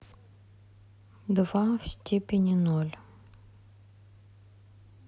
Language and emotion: Russian, neutral